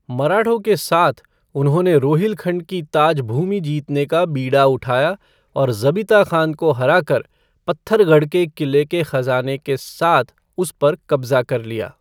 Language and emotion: Hindi, neutral